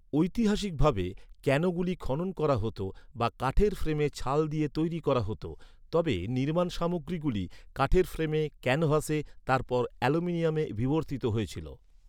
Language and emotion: Bengali, neutral